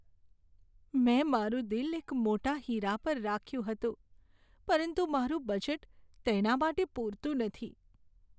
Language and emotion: Gujarati, sad